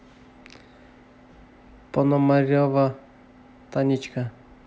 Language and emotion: Russian, neutral